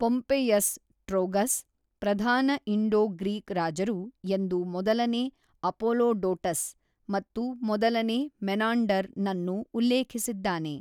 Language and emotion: Kannada, neutral